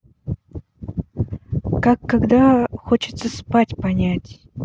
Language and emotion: Russian, neutral